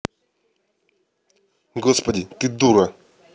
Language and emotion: Russian, angry